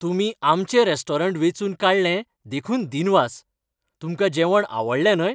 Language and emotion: Goan Konkani, happy